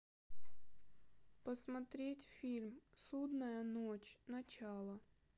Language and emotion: Russian, sad